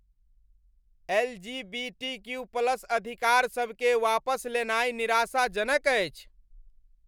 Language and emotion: Maithili, angry